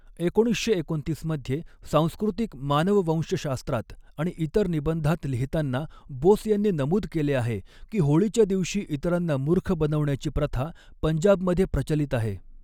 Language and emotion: Marathi, neutral